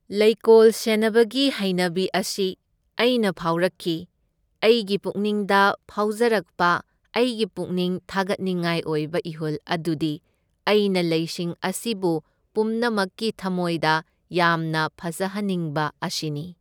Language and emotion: Manipuri, neutral